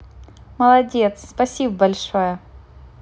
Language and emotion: Russian, positive